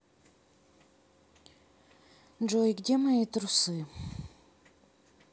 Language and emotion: Russian, sad